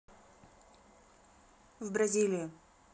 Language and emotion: Russian, neutral